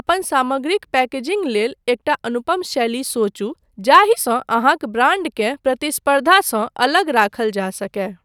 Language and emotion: Maithili, neutral